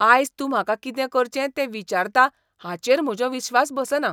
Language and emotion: Goan Konkani, disgusted